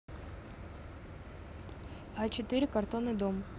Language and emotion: Russian, neutral